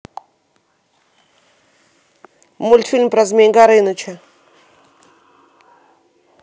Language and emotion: Russian, neutral